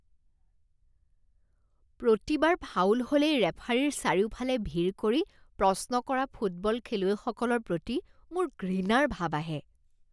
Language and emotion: Assamese, disgusted